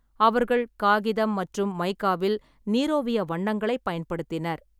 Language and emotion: Tamil, neutral